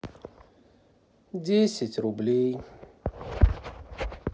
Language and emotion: Russian, sad